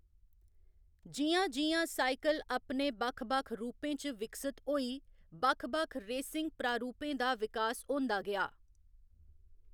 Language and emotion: Dogri, neutral